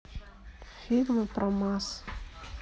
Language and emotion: Russian, neutral